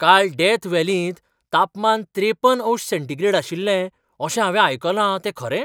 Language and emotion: Goan Konkani, surprised